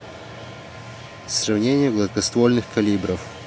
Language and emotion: Russian, neutral